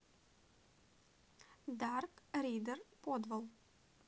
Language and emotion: Russian, neutral